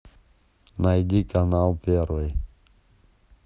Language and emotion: Russian, neutral